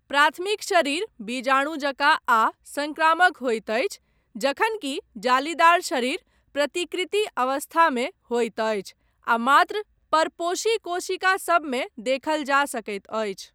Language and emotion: Maithili, neutral